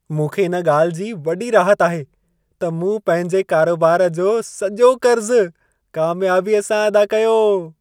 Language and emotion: Sindhi, happy